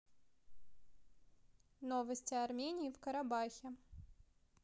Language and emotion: Russian, neutral